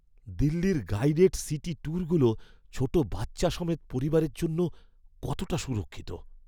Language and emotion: Bengali, fearful